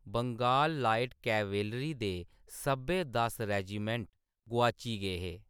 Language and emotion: Dogri, neutral